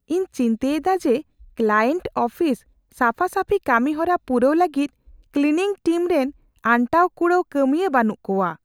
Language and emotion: Santali, fearful